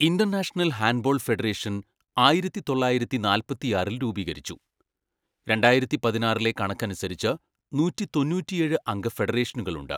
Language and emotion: Malayalam, neutral